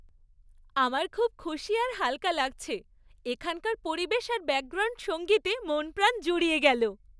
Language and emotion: Bengali, happy